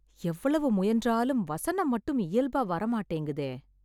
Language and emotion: Tamil, sad